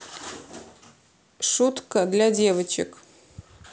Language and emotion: Russian, neutral